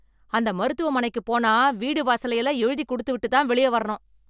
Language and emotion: Tamil, angry